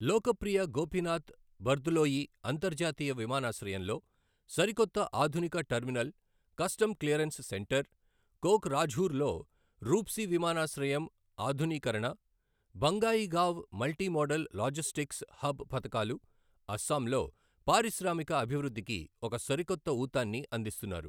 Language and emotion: Telugu, neutral